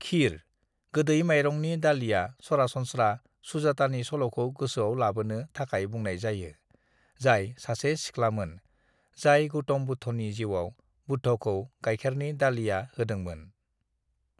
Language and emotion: Bodo, neutral